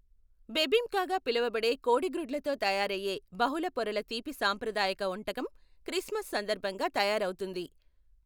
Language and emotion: Telugu, neutral